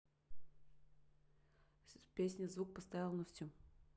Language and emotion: Russian, neutral